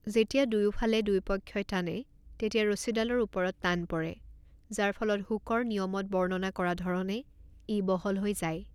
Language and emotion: Assamese, neutral